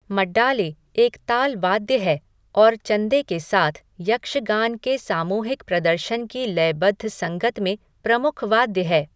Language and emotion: Hindi, neutral